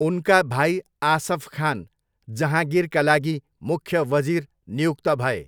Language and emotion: Nepali, neutral